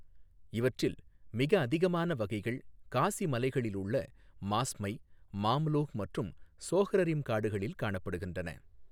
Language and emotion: Tamil, neutral